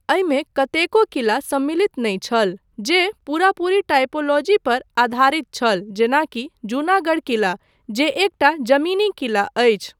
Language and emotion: Maithili, neutral